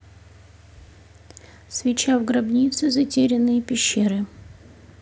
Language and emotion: Russian, neutral